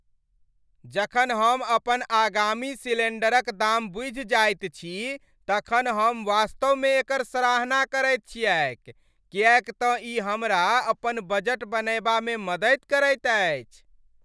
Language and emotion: Maithili, happy